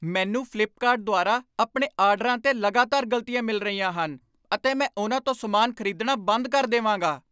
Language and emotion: Punjabi, angry